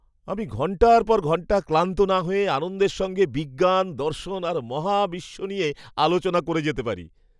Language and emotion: Bengali, happy